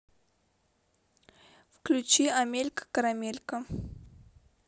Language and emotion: Russian, neutral